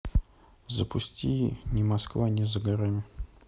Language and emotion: Russian, neutral